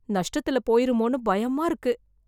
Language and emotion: Tamil, fearful